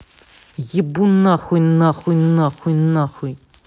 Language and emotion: Russian, angry